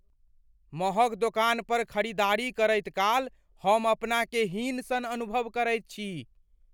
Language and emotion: Maithili, fearful